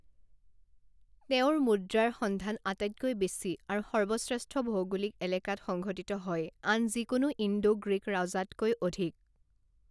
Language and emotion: Assamese, neutral